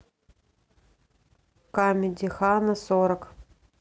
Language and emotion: Russian, neutral